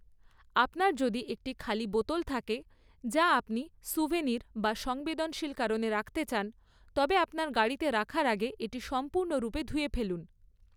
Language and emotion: Bengali, neutral